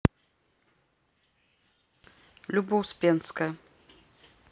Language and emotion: Russian, neutral